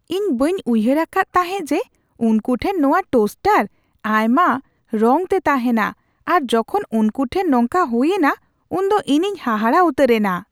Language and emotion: Santali, surprised